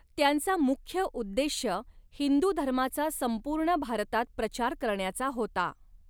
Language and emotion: Marathi, neutral